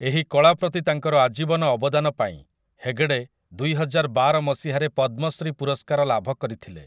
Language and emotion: Odia, neutral